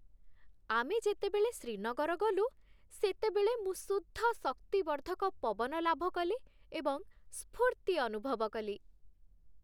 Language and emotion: Odia, happy